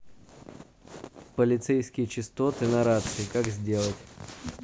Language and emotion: Russian, neutral